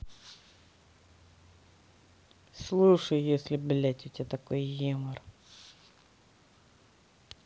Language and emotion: Russian, angry